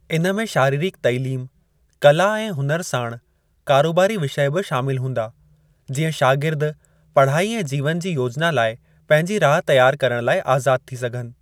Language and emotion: Sindhi, neutral